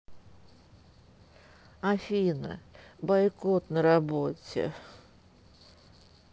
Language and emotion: Russian, sad